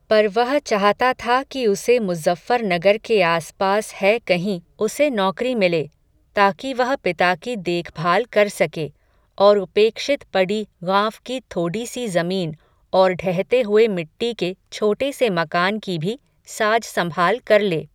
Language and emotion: Hindi, neutral